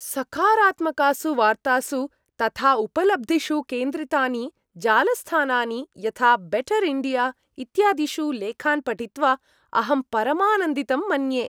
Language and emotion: Sanskrit, happy